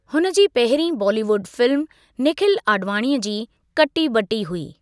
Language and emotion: Sindhi, neutral